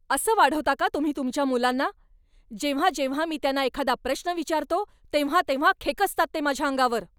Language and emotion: Marathi, angry